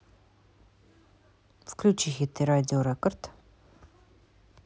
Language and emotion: Russian, neutral